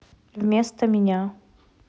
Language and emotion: Russian, neutral